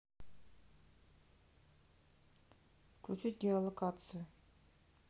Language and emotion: Russian, neutral